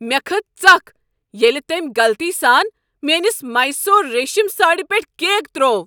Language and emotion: Kashmiri, angry